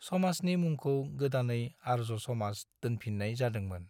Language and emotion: Bodo, neutral